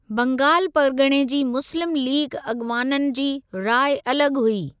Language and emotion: Sindhi, neutral